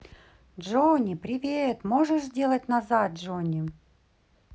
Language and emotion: Russian, positive